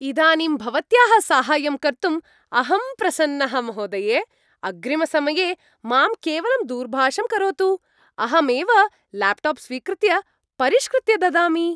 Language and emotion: Sanskrit, happy